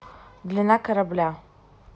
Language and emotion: Russian, neutral